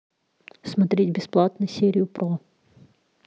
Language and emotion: Russian, neutral